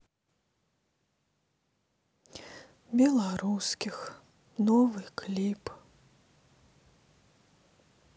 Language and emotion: Russian, sad